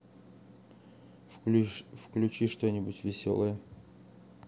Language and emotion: Russian, neutral